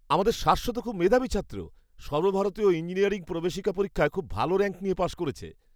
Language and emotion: Bengali, happy